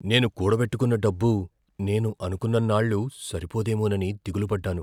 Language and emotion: Telugu, fearful